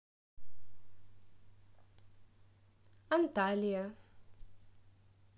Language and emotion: Russian, positive